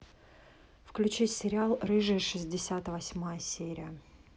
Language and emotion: Russian, neutral